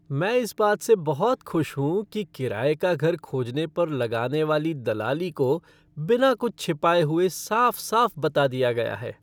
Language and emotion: Hindi, happy